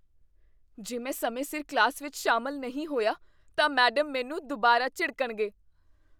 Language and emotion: Punjabi, fearful